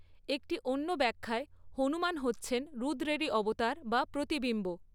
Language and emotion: Bengali, neutral